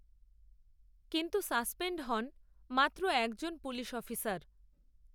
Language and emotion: Bengali, neutral